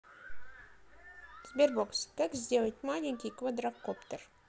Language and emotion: Russian, neutral